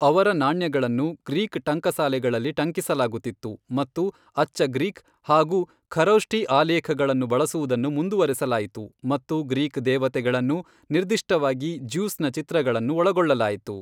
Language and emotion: Kannada, neutral